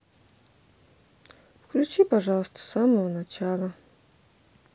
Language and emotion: Russian, sad